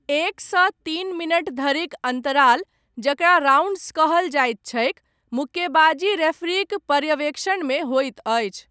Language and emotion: Maithili, neutral